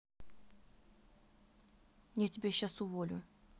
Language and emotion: Russian, neutral